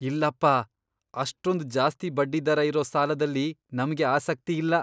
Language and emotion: Kannada, disgusted